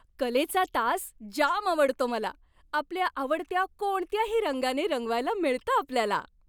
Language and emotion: Marathi, happy